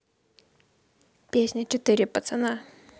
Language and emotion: Russian, positive